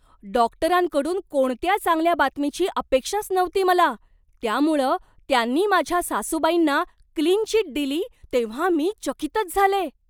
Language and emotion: Marathi, surprised